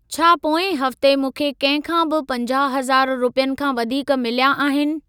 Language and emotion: Sindhi, neutral